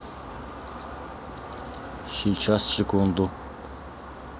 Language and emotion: Russian, neutral